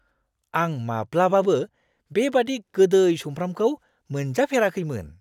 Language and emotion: Bodo, surprised